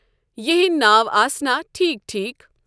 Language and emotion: Kashmiri, neutral